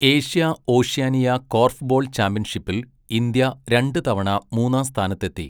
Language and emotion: Malayalam, neutral